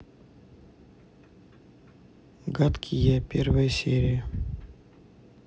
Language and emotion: Russian, neutral